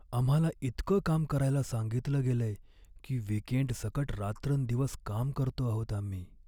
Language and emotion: Marathi, sad